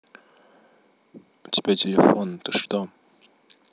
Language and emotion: Russian, neutral